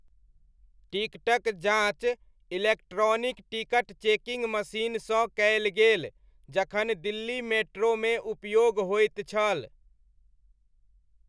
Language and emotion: Maithili, neutral